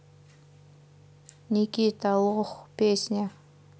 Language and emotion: Russian, neutral